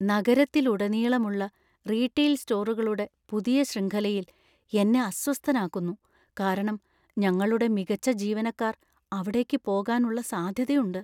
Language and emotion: Malayalam, fearful